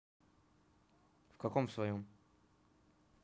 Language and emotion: Russian, neutral